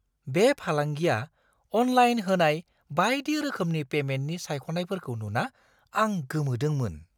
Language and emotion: Bodo, surprised